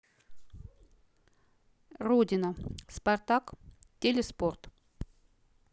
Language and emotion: Russian, neutral